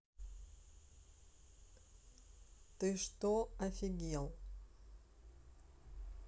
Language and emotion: Russian, neutral